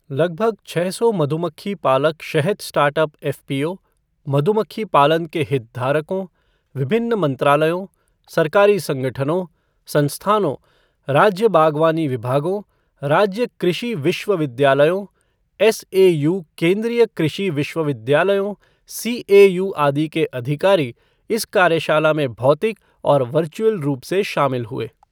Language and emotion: Hindi, neutral